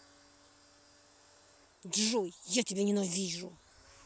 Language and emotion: Russian, angry